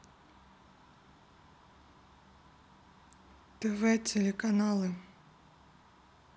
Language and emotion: Russian, neutral